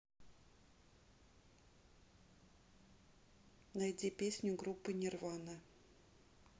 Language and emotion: Russian, neutral